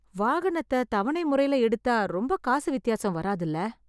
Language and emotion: Tamil, fearful